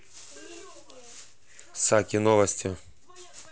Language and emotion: Russian, neutral